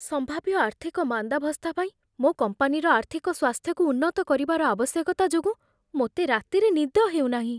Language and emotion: Odia, fearful